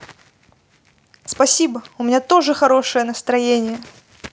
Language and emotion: Russian, neutral